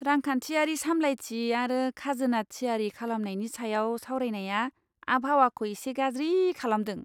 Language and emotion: Bodo, disgusted